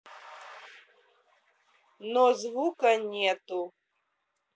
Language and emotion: Russian, neutral